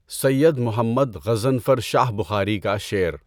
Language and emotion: Urdu, neutral